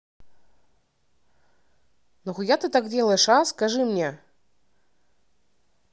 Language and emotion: Russian, angry